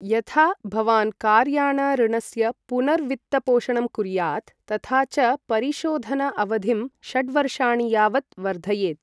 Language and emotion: Sanskrit, neutral